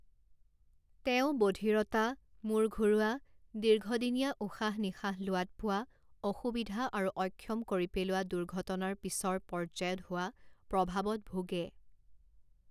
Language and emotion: Assamese, neutral